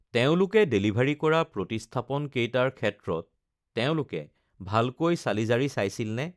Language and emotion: Assamese, neutral